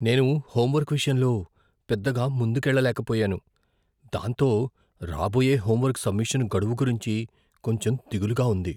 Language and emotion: Telugu, fearful